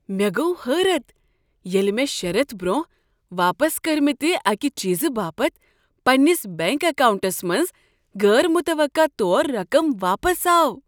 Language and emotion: Kashmiri, surprised